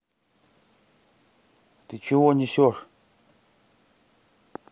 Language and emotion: Russian, neutral